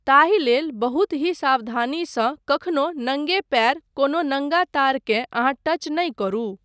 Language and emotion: Maithili, neutral